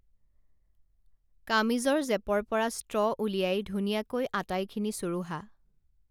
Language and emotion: Assamese, neutral